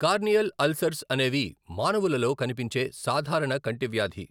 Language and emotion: Telugu, neutral